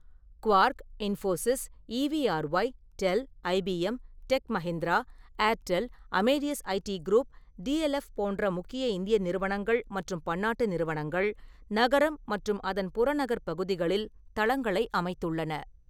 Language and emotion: Tamil, neutral